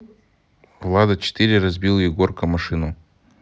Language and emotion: Russian, neutral